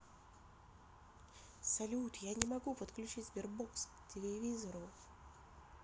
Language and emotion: Russian, neutral